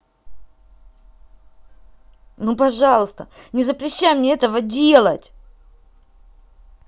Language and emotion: Russian, angry